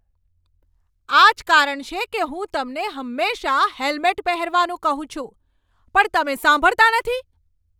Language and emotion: Gujarati, angry